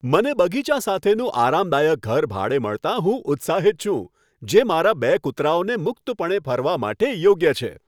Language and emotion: Gujarati, happy